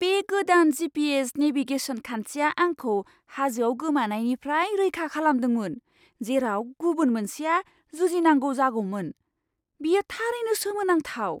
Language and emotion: Bodo, surprised